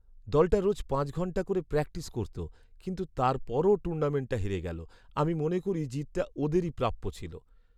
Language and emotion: Bengali, sad